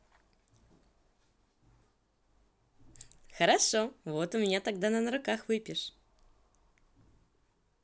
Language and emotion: Russian, positive